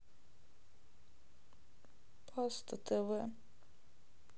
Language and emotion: Russian, sad